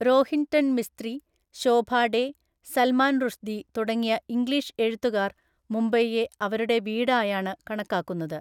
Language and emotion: Malayalam, neutral